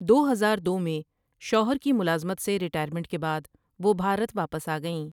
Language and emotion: Urdu, neutral